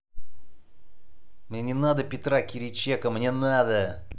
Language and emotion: Russian, angry